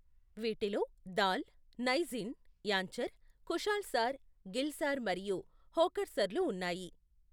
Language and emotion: Telugu, neutral